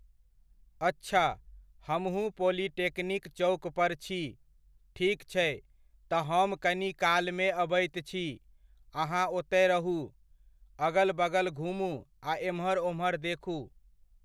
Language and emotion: Maithili, neutral